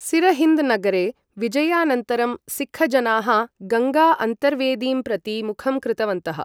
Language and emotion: Sanskrit, neutral